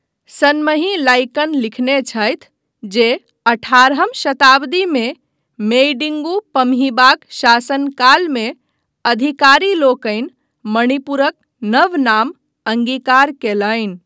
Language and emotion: Maithili, neutral